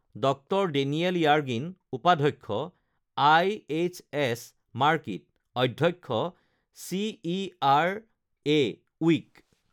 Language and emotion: Assamese, neutral